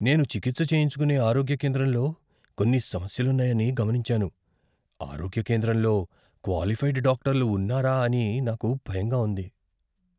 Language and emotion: Telugu, fearful